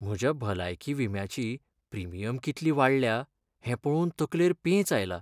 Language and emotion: Goan Konkani, sad